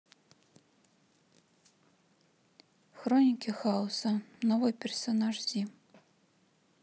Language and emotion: Russian, sad